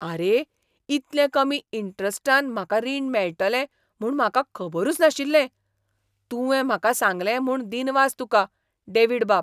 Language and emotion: Goan Konkani, surprised